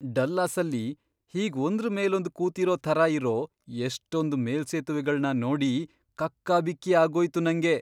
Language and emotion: Kannada, surprised